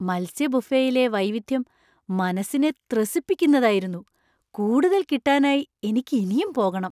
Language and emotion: Malayalam, surprised